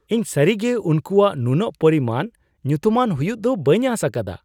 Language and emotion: Santali, surprised